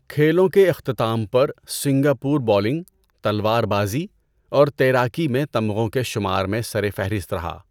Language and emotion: Urdu, neutral